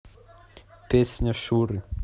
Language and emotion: Russian, neutral